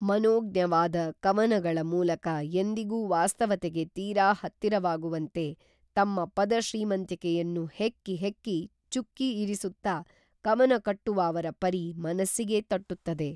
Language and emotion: Kannada, neutral